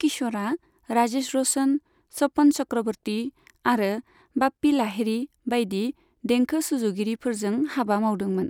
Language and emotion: Bodo, neutral